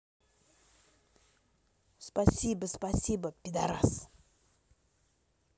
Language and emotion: Russian, angry